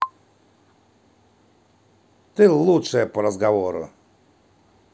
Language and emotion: Russian, positive